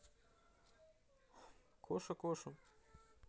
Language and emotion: Russian, neutral